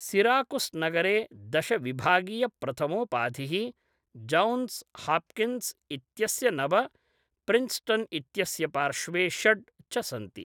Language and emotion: Sanskrit, neutral